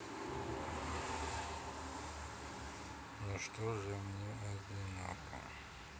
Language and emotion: Russian, sad